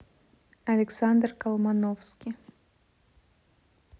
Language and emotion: Russian, neutral